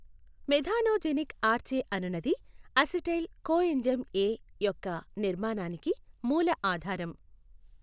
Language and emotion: Telugu, neutral